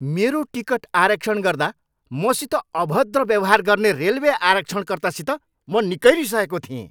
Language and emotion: Nepali, angry